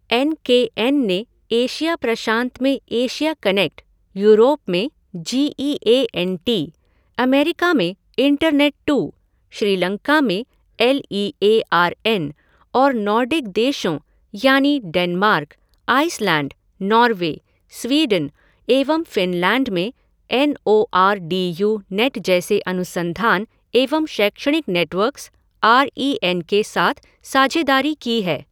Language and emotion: Hindi, neutral